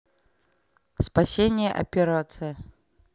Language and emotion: Russian, neutral